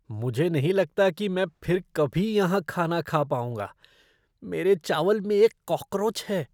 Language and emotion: Hindi, disgusted